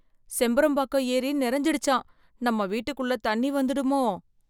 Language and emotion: Tamil, fearful